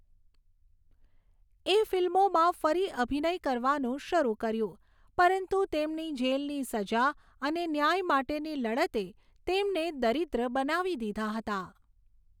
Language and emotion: Gujarati, neutral